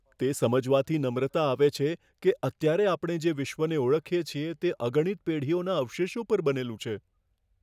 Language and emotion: Gujarati, fearful